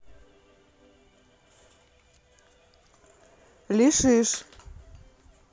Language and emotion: Russian, neutral